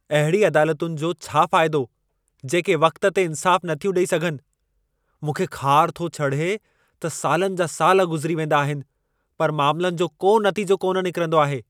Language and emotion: Sindhi, angry